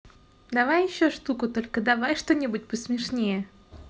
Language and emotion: Russian, positive